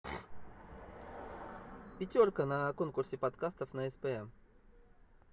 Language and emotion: Russian, neutral